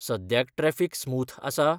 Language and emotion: Goan Konkani, neutral